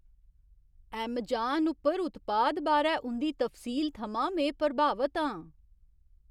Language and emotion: Dogri, surprised